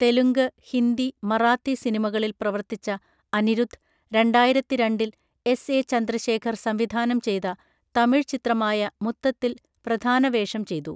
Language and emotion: Malayalam, neutral